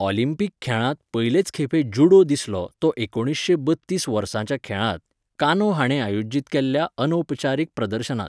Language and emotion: Goan Konkani, neutral